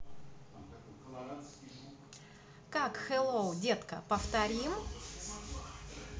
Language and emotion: Russian, positive